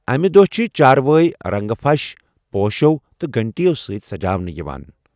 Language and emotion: Kashmiri, neutral